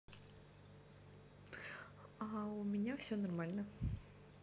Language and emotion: Russian, positive